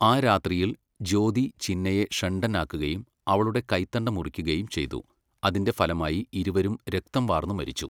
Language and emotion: Malayalam, neutral